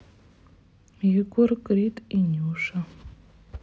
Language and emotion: Russian, sad